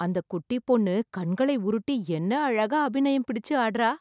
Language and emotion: Tamil, surprised